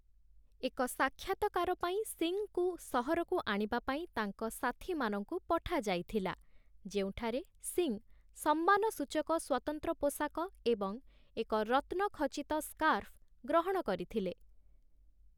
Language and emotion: Odia, neutral